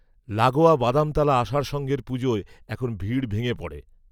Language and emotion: Bengali, neutral